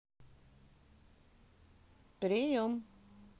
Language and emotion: Russian, positive